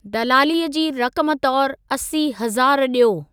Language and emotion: Sindhi, neutral